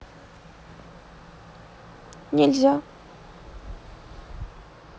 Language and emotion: Russian, sad